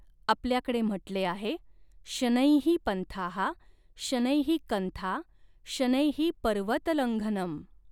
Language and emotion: Marathi, neutral